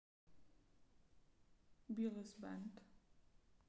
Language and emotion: Russian, neutral